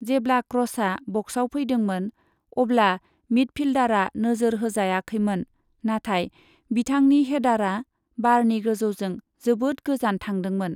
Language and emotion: Bodo, neutral